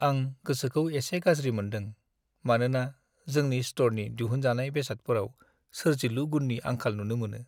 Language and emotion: Bodo, sad